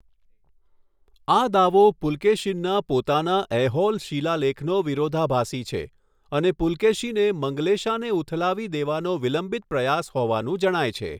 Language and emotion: Gujarati, neutral